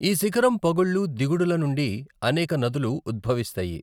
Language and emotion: Telugu, neutral